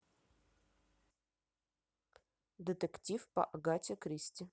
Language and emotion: Russian, neutral